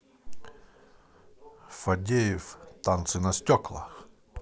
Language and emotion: Russian, positive